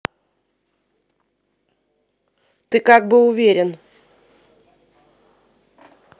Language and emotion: Russian, angry